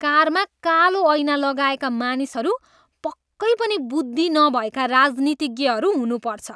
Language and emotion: Nepali, disgusted